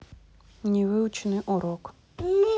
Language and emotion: Russian, neutral